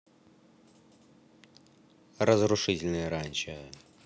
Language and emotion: Russian, neutral